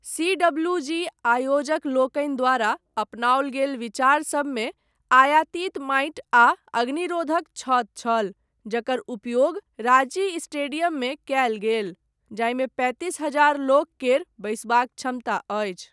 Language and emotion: Maithili, neutral